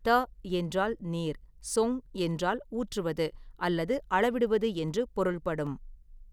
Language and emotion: Tamil, neutral